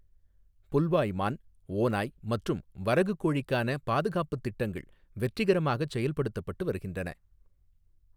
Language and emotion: Tamil, neutral